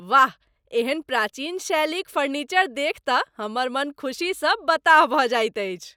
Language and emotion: Maithili, happy